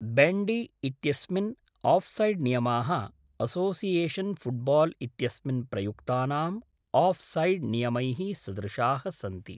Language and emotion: Sanskrit, neutral